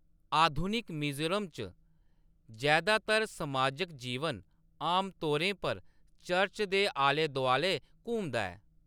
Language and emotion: Dogri, neutral